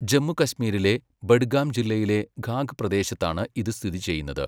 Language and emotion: Malayalam, neutral